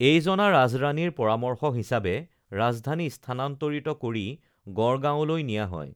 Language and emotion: Assamese, neutral